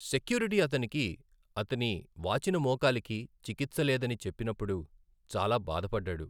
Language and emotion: Telugu, sad